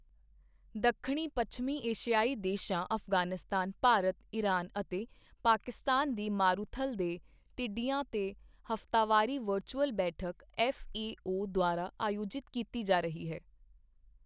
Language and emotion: Punjabi, neutral